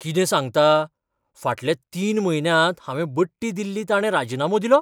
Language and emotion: Goan Konkani, surprised